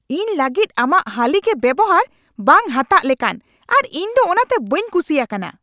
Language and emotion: Santali, angry